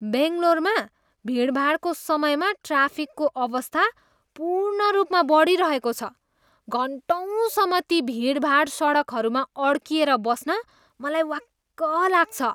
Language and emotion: Nepali, disgusted